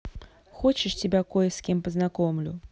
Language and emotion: Russian, neutral